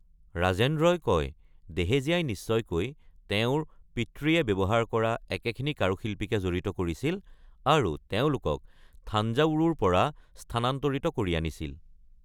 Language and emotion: Assamese, neutral